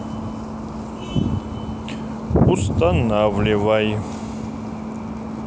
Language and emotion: Russian, neutral